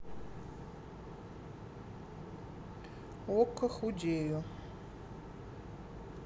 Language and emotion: Russian, neutral